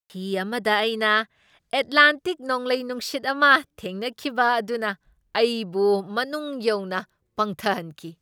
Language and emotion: Manipuri, surprised